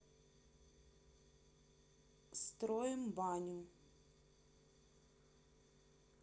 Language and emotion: Russian, neutral